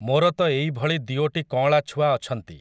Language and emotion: Odia, neutral